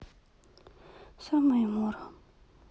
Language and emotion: Russian, sad